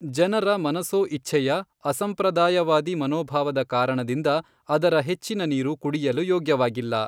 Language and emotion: Kannada, neutral